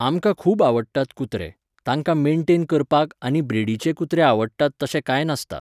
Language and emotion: Goan Konkani, neutral